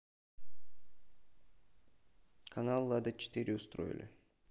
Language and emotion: Russian, neutral